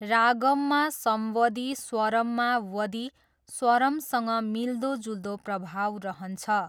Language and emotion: Nepali, neutral